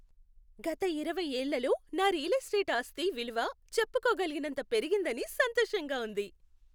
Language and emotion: Telugu, happy